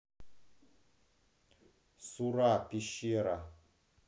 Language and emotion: Russian, neutral